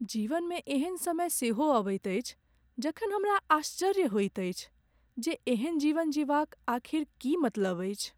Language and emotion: Maithili, sad